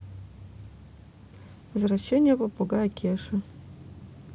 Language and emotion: Russian, neutral